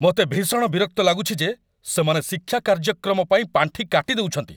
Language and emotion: Odia, angry